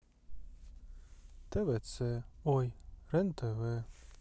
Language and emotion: Russian, sad